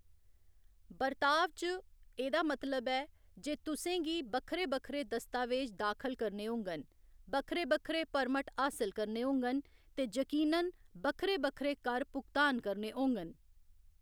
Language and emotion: Dogri, neutral